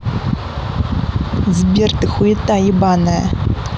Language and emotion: Russian, angry